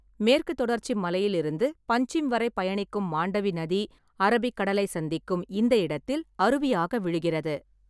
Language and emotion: Tamil, neutral